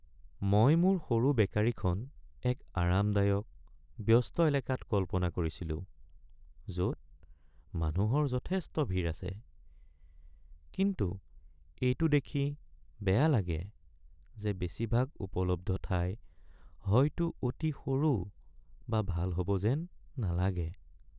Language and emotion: Assamese, sad